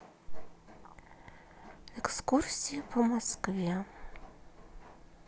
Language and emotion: Russian, sad